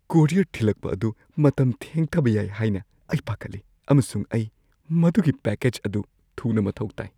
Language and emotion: Manipuri, fearful